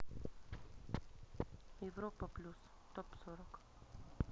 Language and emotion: Russian, neutral